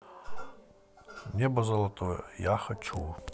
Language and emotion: Russian, neutral